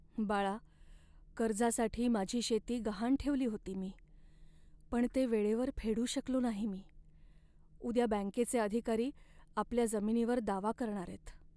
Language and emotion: Marathi, sad